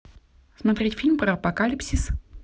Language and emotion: Russian, positive